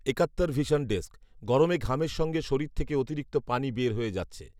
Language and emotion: Bengali, neutral